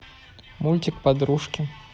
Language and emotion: Russian, neutral